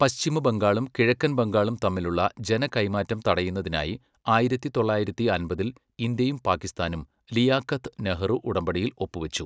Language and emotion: Malayalam, neutral